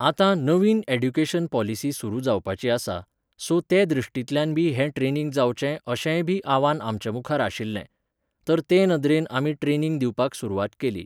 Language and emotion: Goan Konkani, neutral